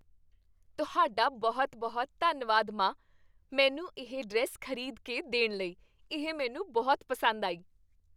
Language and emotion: Punjabi, happy